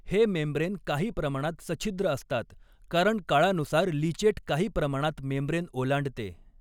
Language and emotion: Marathi, neutral